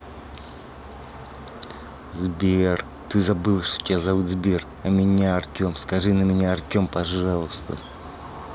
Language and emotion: Russian, angry